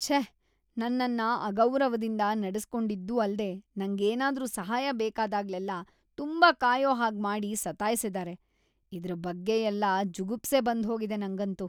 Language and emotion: Kannada, disgusted